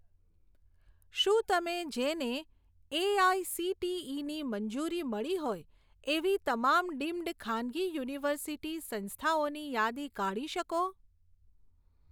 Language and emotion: Gujarati, neutral